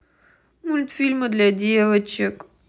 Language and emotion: Russian, sad